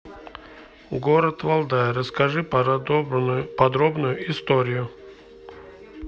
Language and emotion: Russian, neutral